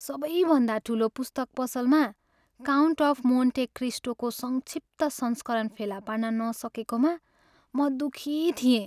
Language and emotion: Nepali, sad